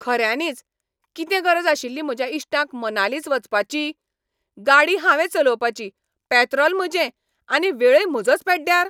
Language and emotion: Goan Konkani, angry